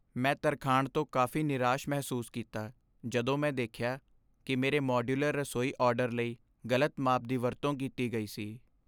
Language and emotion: Punjabi, sad